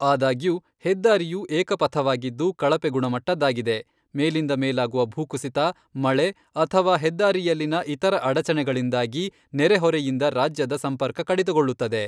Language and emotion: Kannada, neutral